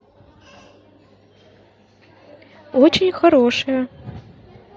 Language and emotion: Russian, neutral